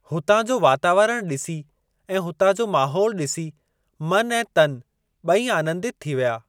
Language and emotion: Sindhi, neutral